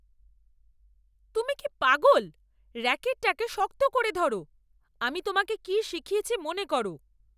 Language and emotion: Bengali, angry